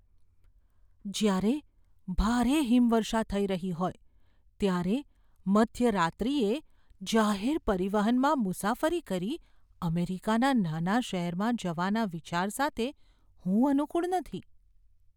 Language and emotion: Gujarati, fearful